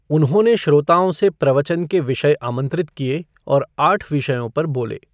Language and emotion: Hindi, neutral